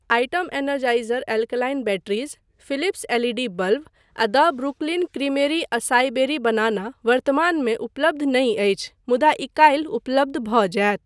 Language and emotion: Maithili, neutral